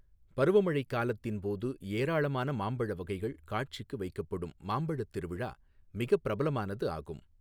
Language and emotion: Tamil, neutral